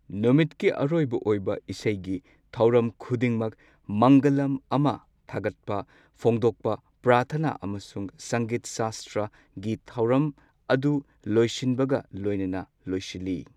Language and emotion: Manipuri, neutral